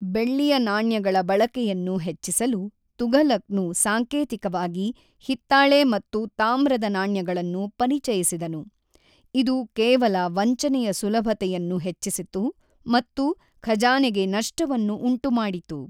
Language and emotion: Kannada, neutral